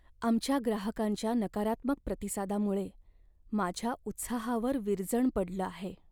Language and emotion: Marathi, sad